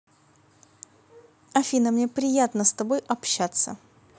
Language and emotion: Russian, positive